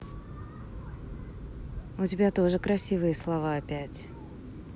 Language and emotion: Russian, neutral